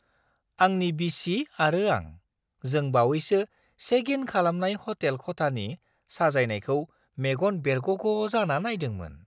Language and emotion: Bodo, surprised